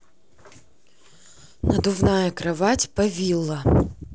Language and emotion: Russian, neutral